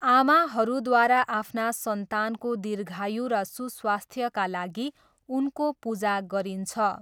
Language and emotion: Nepali, neutral